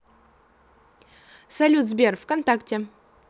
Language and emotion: Russian, positive